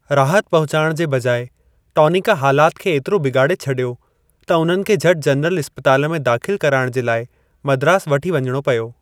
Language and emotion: Sindhi, neutral